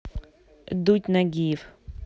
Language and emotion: Russian, neutral